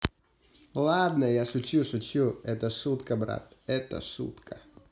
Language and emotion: Russian, positive